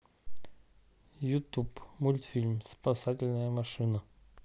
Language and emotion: Russian, neutral